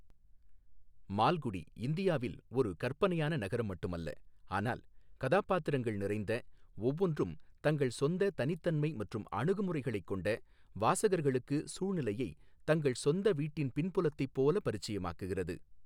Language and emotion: Tamil, neutral